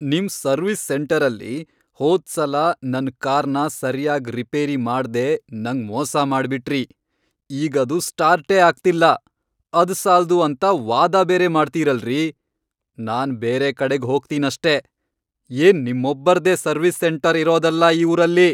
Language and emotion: Kannada, angry